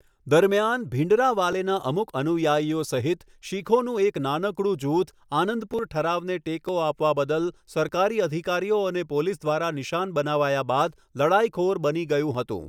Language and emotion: Gujarati, neutral